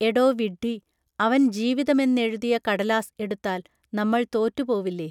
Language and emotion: Malayalam, neutral